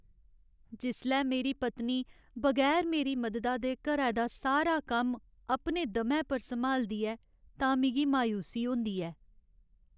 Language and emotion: Dogri, sad